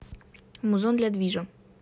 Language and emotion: Russian, neutral